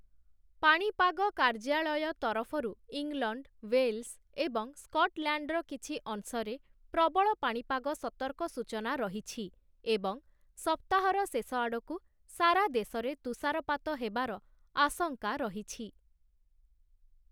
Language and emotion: Odia, neutral